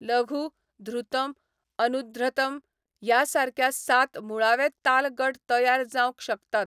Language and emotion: Goan Konkani, neutral